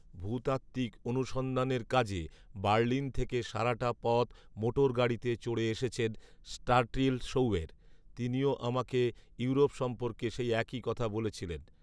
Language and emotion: Bengali, neutral